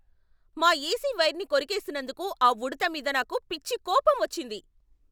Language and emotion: Telugu, angry